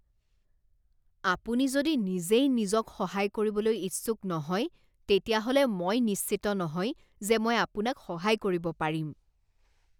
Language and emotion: Assamese, disgusted